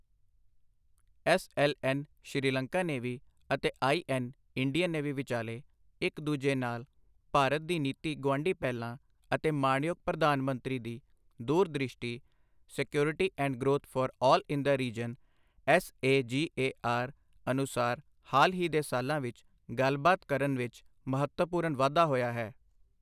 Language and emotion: Punjabi, neutral